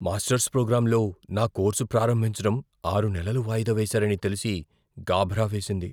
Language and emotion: Telugu, fearful